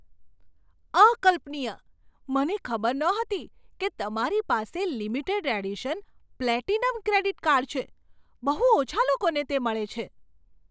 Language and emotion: Gujarati, surprised